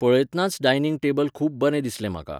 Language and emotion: Goan Konkani, neutral